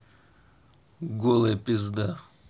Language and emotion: Russian, angry